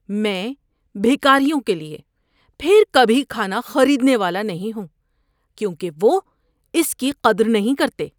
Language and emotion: Urdu, disgusted